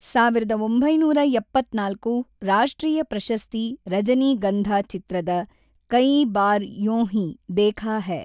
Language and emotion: Kannada, neutral